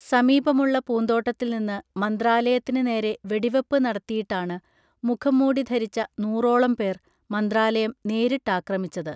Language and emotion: Malayalam, neutral